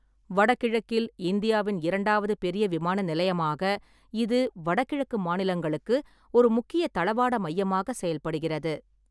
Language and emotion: Tamil, neutral